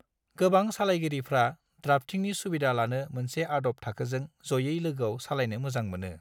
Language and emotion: Bodo, neutral